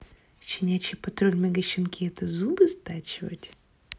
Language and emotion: Russian, neutral